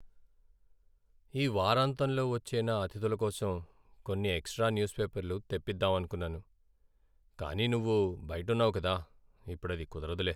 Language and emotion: Telugu, sad